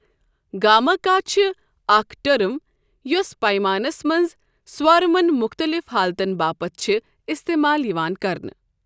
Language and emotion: Kashmiri, neutral